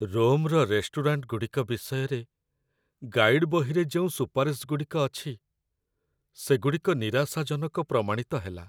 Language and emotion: Odia, sad